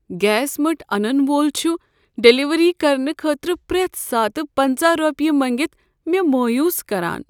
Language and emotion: Kashmiri, sad